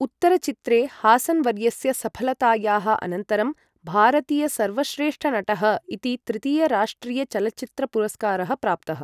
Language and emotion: Sanskrit, neutral